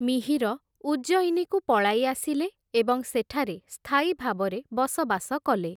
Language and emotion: Odia, neutral